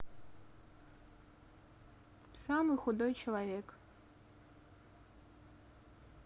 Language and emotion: Russian, neutral